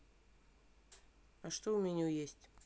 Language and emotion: Russian, neutral